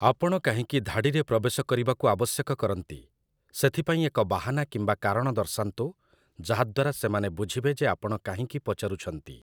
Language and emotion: Odia, neutral